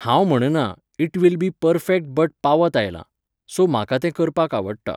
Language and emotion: Goan Konkani, neutral